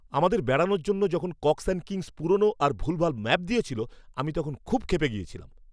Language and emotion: Bengali, angry